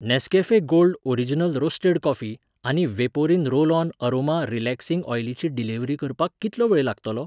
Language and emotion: Goan Konkani, neutral